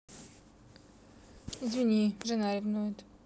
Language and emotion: Russian, neutral